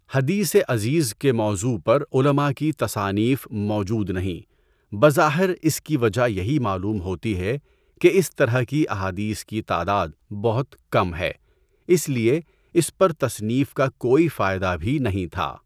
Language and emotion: Urdu, neutral